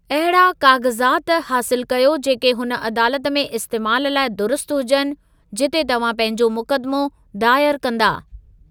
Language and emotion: Sindhi, neutral